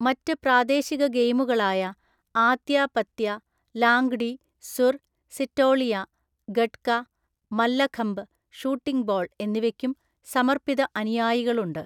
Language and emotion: Malayalam, neutral